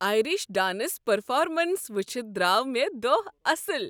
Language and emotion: Kashmiri, happy